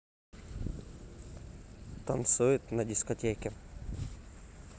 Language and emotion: Russian, neutral